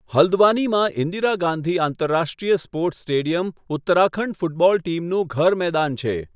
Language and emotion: Gujarati, neutral